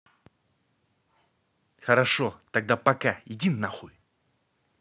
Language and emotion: Russian, angry